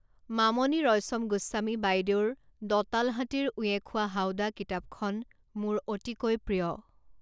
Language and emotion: Assamese, neutral